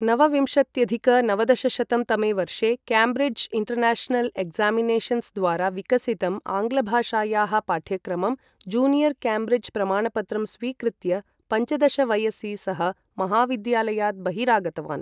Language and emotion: Sanskrit, neutral